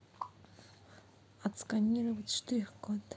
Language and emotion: Russian, neutral